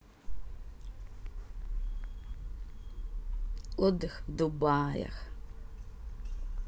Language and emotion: Russian, positive